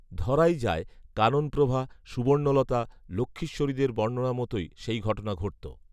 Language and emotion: Bengali, neutral